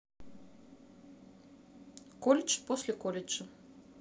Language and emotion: Russian, neutral